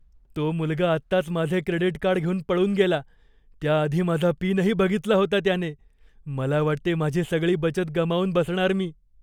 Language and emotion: Marathi, fearful